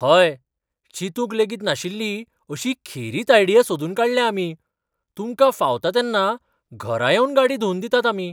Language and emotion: Goan Konkani, surprised